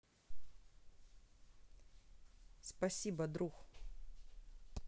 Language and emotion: Russian, neutral